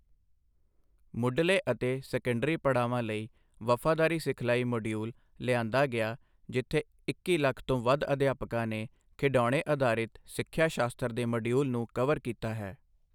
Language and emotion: Punjabi, neutral